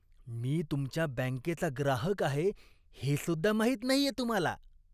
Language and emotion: Marathi, disgusted